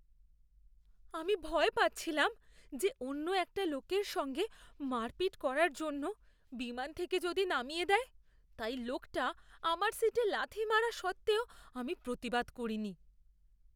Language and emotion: Bengali, fearful